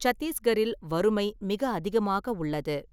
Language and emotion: Tamil, neutral